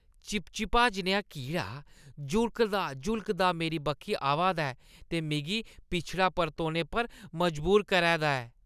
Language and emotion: Dogri, disgusted